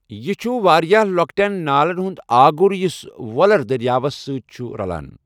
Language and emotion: Kashmiri, neutral